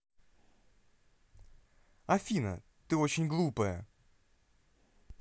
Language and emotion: Russian, angry